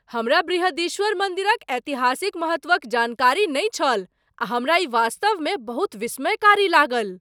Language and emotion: Maithili, surprised